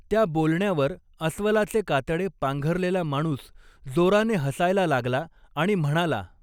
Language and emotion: Marathi, neutral